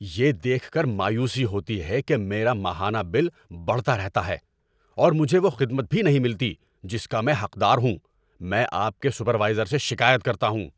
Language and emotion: Urdu, angry